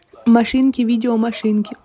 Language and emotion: Russian, neutral